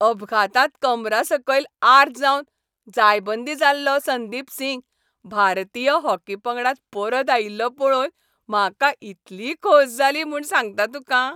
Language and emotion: Goan Konkani, happy